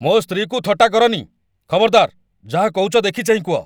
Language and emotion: Odia, angry